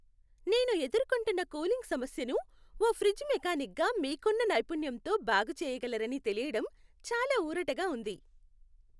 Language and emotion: Telugu, happy